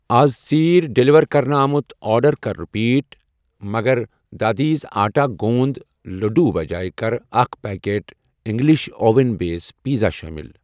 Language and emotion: Kashmiri, neutral